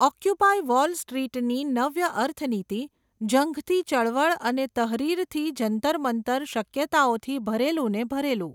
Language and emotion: Gujarati, neutral